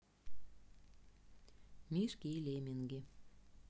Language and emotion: Russian, neutral